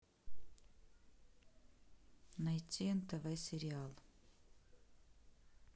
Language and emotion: Russian, neutral